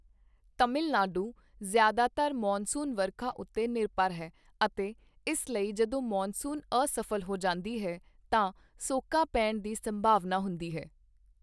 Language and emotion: Punjabi, neutral